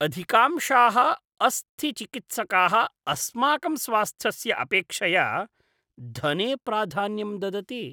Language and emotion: Sanskrit, disgusted